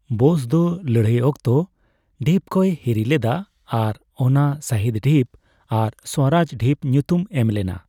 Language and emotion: Santali, neutral